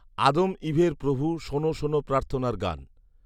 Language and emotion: Bengali, neutral